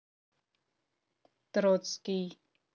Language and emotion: Russian, neutral